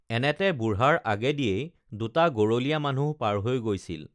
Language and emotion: Assamese, neutral